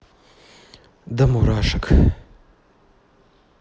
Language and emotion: Russian, neutral